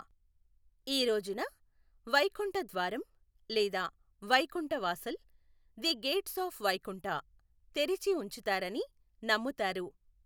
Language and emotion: Telugu, neutral